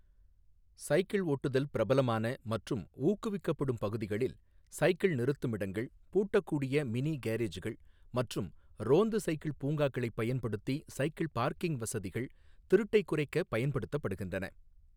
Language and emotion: Tamil, neutral